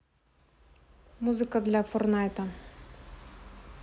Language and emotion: Russian, neutral